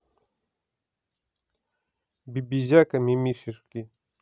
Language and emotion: Russian, neutral